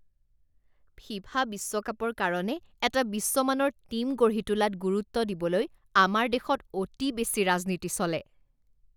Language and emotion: Assamese, disgusted